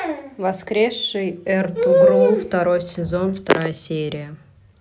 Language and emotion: Russian, neutral